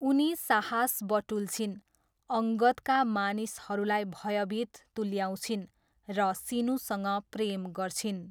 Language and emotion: Nepali, neutral